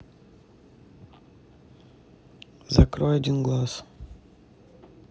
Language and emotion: Russian, neutral